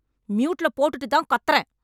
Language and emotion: Tamil, angry